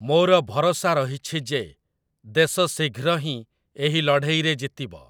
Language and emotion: Odia, neutral